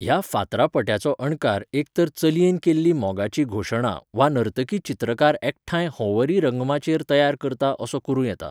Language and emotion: Goan Konkani, neutral